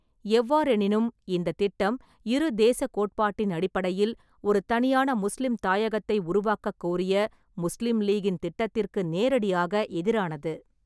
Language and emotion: Tamil, neutral